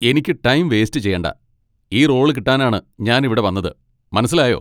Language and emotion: Malayalam, angry